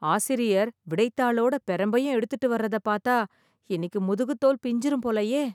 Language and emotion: Tamil, fearful